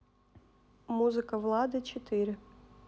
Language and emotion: Russian, neutral